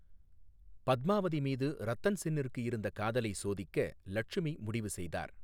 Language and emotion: Tamil, neutral